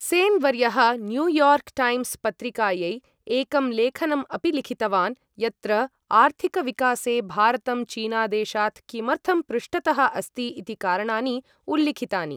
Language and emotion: Sanskrit, neutral